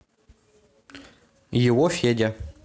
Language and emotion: Russian, neutral